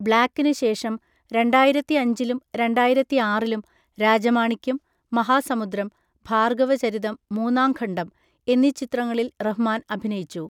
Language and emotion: Malayalam, neutral